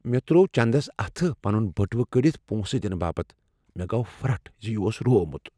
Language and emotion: Kashmiri, fearful